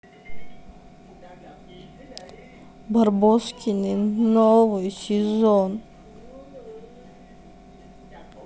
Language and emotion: Russian, sad